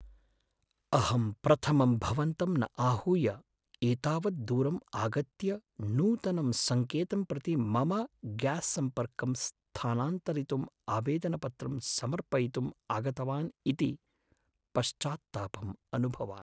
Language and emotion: Sanskrit, sad